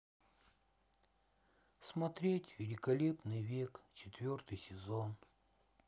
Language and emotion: Russian, sad